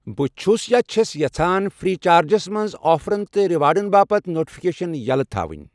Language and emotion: Kashmiri, neutral